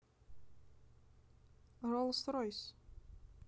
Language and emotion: Russian, neutral